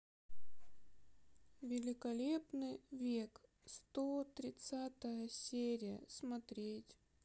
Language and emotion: Russian, sad